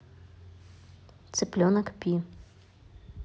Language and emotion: Russian, neutral